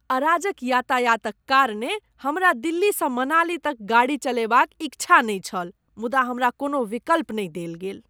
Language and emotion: Maithili, disgusted